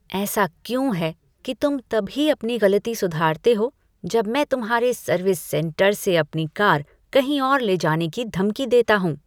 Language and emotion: Hindi, disgusted